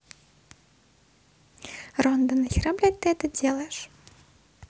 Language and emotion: Russian, neutral